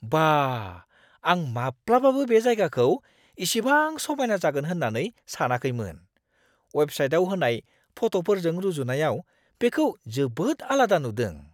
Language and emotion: Bodo, surprised